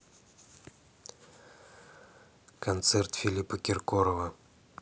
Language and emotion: Russian, neutral